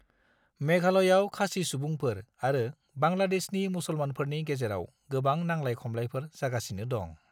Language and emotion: Bodo, neutral